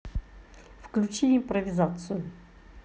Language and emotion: Russian, neutral